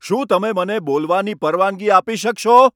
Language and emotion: Gujarati, angry